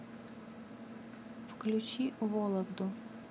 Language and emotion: Russian, neutral